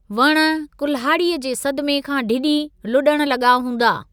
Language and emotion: Sindhi, neutral